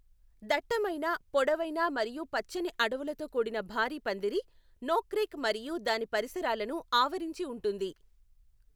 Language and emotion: Telugu, neutral